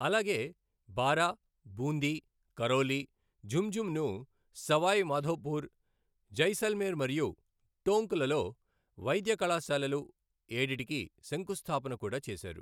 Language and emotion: Telugu, neutral